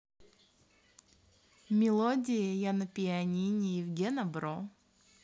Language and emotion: Russian, positive